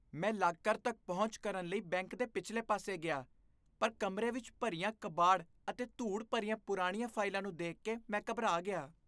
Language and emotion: Punjabi, disgusted